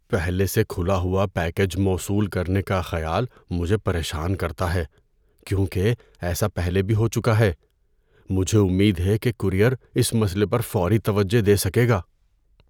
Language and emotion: Urdu, fearful